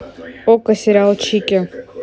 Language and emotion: Russian, neutral